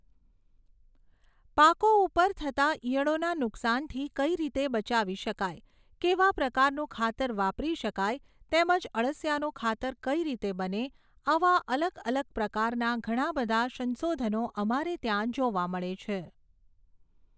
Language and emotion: Gujarati, neutral